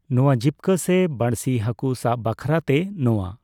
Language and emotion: Santali, neutral